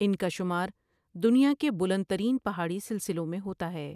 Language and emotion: Urdu, neutral